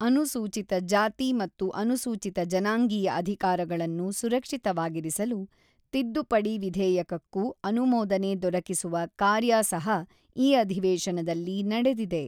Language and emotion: Kannada, neutral